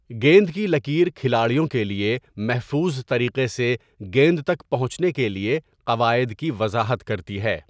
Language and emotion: Urdu, neutral